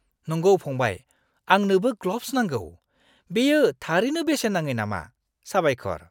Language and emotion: Bodo, happy